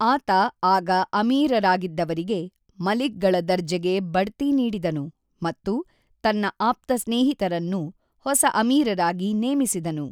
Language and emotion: Kannada, neutral